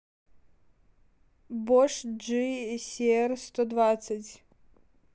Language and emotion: Russian, neutral